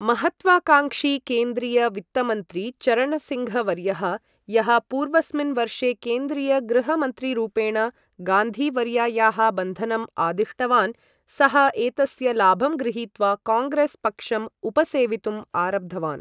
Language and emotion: Sanskrit, neutral